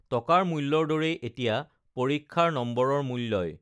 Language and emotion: Assamese, neutral